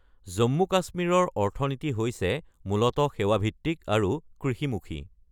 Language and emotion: Assamese, neutral